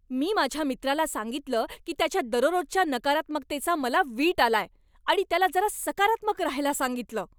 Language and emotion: Marathi, angry